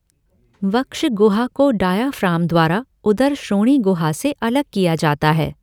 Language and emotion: Hindi, neutral